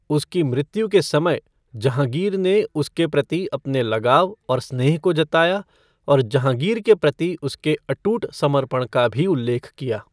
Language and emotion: Hindi, neutral